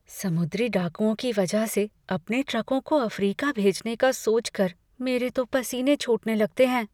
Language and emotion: Hindi, fearful